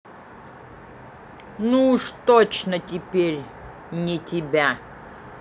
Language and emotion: Russian, neutral